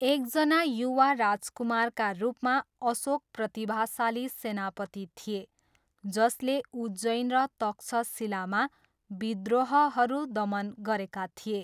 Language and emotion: Nepali, neutral